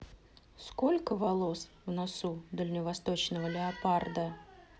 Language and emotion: Russian, neutral